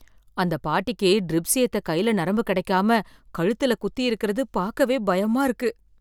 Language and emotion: Tamil, fearful